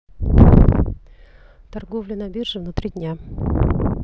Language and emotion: Russian, neutral